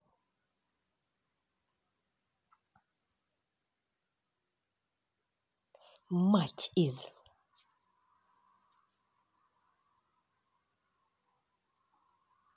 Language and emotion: Russian, angry